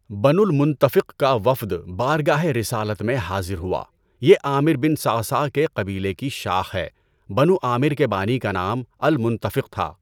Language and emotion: Urdu, neutral